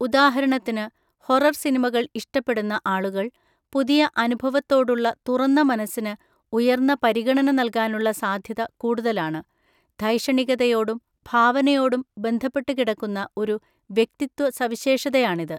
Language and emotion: Malayalam, neutral